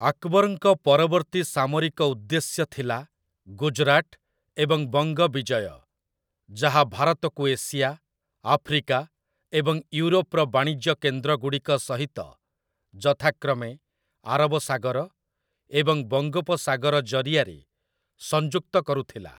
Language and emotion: Odia, neutral